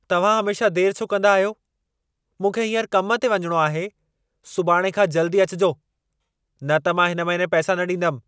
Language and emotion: Sindhi, angry